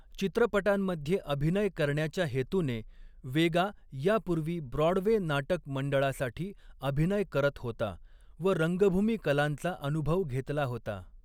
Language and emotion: Marathi, neutral